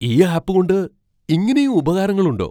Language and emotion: Malayalam, surprised